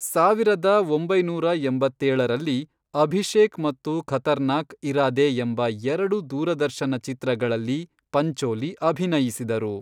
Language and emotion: Kannada, neutral